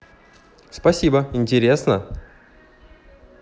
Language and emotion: Russian, positive